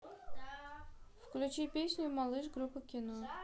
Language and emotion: Russian, neutral